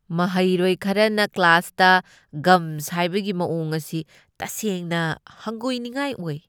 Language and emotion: Manipuri, disgusted